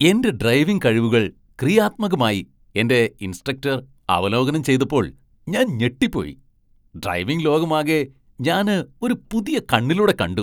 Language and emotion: Malayalam, surprised